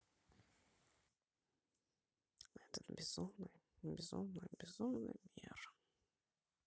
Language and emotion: Russian, sad